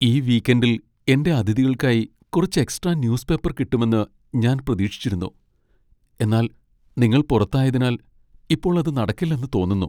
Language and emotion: Malayalam, sad